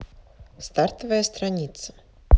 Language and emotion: Russian, neutral